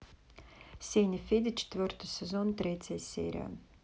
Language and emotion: Russian, neutral